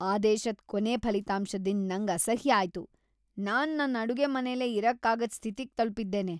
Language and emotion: Kannada, disgusted